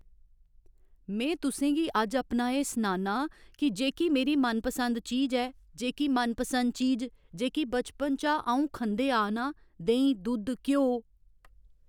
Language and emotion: Dogri, neutral